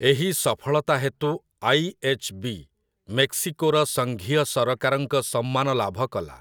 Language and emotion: Odia, neutral